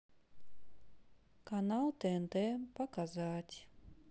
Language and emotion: Russian, sad